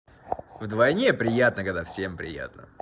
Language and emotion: Russian, positive